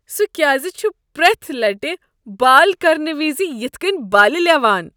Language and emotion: Kashmiri, disgusted